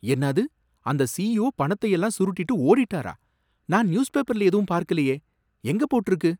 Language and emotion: Tamil, surprised